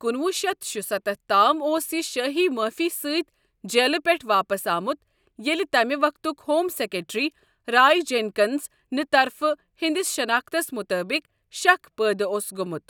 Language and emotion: Kashmiri, neutral